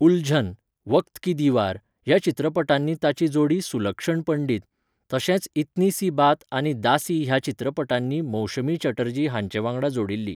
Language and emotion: Goan Konkani, neutral